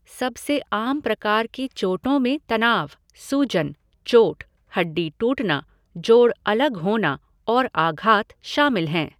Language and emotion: Hindi, neutral